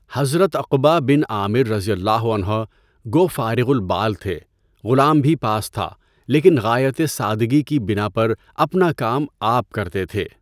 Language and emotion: Urdu, neutral